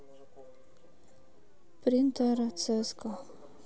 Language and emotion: Russian, neutral